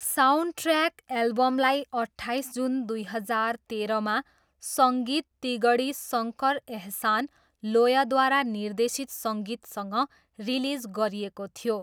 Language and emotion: Nepali, neutral